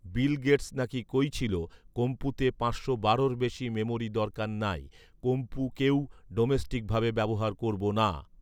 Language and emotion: Bengali, neutral